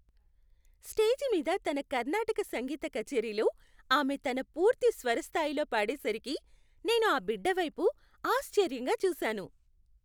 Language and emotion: Telugu, happy